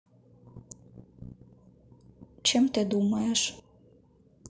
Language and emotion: Russian, neutral